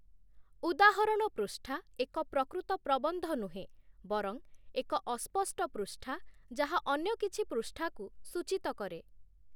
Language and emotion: Odia, neutral